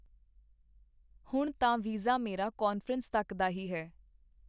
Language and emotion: Punjabi, neutral